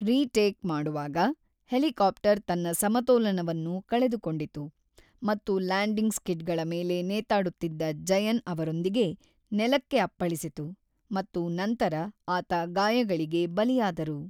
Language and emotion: Kannada, neutral